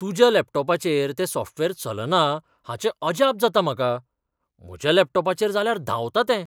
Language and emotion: Goan Konkani, surprised